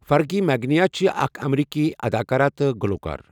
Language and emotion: Kashmiri, neutral